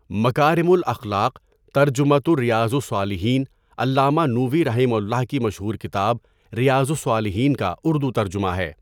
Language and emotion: Urdu, neutral